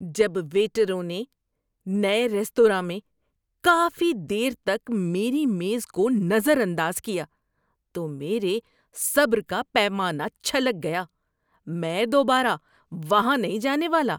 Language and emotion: Urdu, disgusted